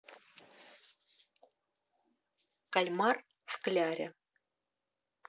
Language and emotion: Russian, neutral